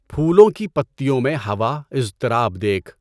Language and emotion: Urdu, neutral